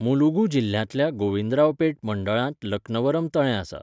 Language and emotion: Goan Konkani, neutral